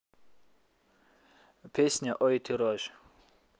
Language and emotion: Russian, neutral